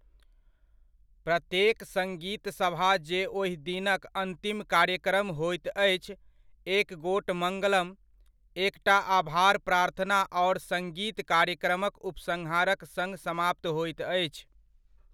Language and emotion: Maithili, neutral